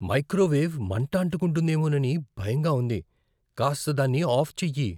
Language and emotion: Telugu, fearful